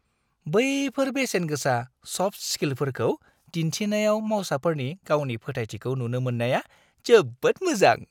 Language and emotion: Bodo, happy